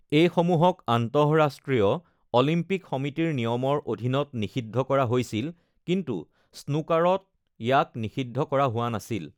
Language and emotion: Assamese, neutral